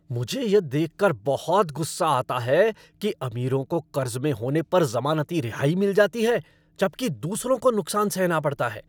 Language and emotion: Hindi, angry